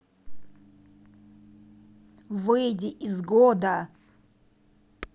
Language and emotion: Russian, angry